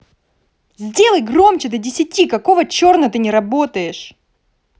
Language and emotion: Russian, angry